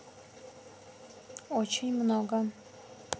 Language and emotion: Russian, neutral